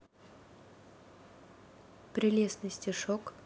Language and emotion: Russian, neutral